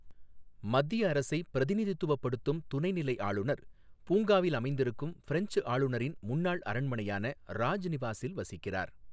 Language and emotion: Tamil, neutral